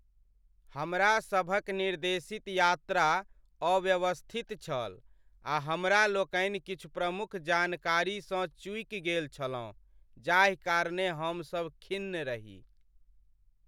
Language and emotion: Maithili, sad